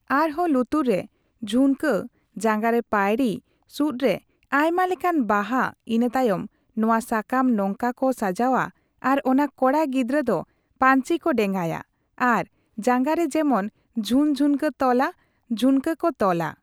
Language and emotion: Santali, neutral